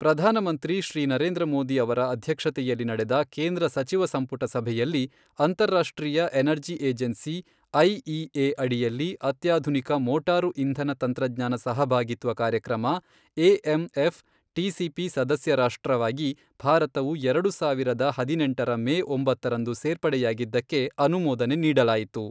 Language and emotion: Kannada, neutral